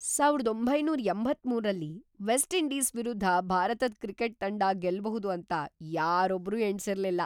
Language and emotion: Kannada, surprised